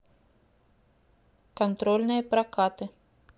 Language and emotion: Russian, neutral